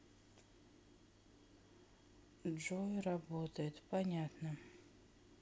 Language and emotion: Russian, sad